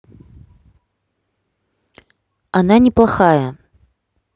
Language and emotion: Russian, neutral